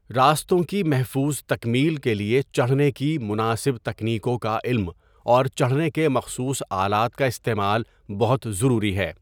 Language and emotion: Urdu, neutral